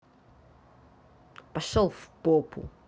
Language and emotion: Russian, angry